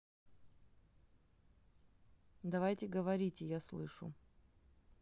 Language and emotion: Russian, neutral